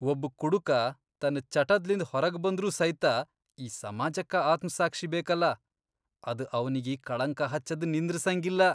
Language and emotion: Kannada, disgusted